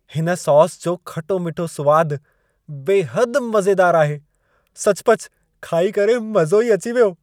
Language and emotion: Sindhi, happy